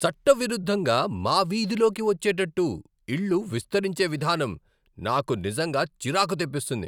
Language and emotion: Telugu, angry